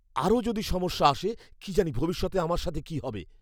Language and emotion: Bengali, fearful